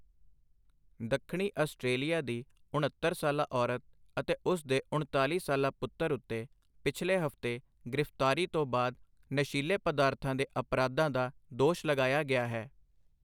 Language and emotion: Punjabi, neutral